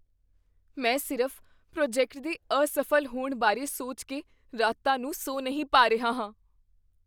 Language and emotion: Punjabi, fearful